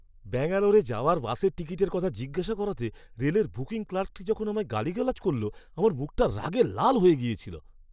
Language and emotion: Bengali, angry